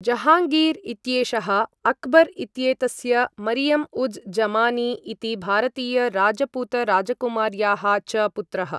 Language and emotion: Sanskrit, neutral